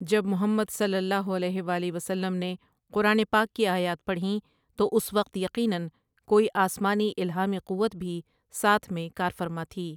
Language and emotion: Urdu, neutral